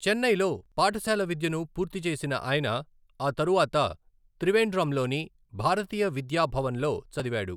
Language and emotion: Telugu, neutral